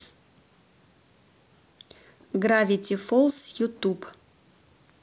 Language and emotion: Russian, neutral